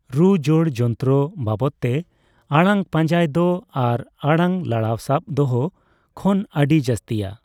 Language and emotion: Santali, neutral